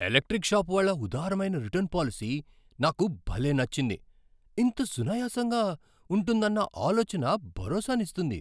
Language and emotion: Telugu, surprised